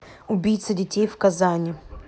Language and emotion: Russian, angry